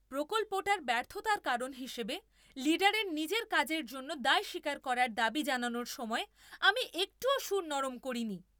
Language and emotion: Bengali, angry